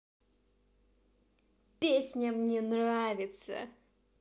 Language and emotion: Russian, angry